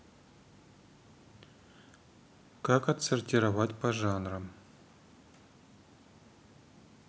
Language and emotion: Russian, neutral